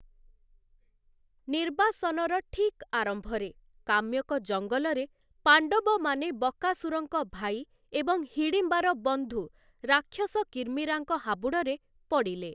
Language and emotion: Odia, neutral